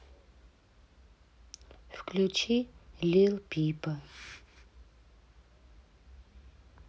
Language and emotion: Russian, neutral